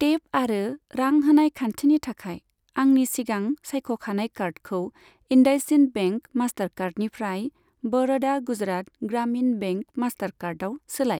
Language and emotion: Bodo, neutral